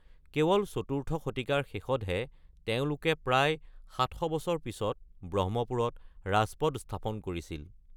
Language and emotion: Assamese, neutral